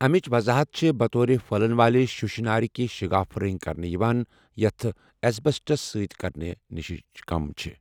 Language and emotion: Kashmiri, neutral